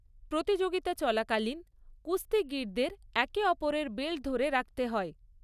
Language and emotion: Bengali, neutral